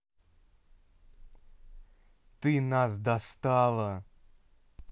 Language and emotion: Russian, angry